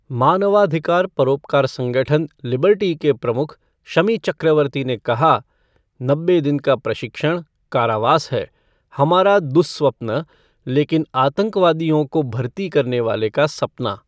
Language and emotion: Hindi, neutral